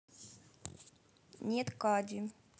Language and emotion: Russian, neutral